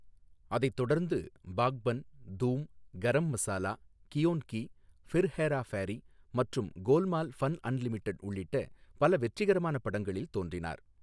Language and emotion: Tamil, neutral